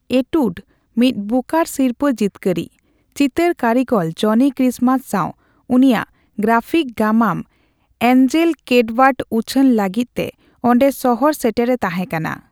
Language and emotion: Santali, neutral